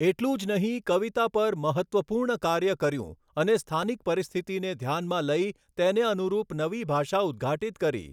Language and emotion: Gujarati, neutral